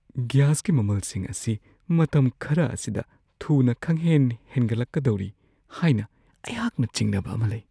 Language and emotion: Manipuri, fearful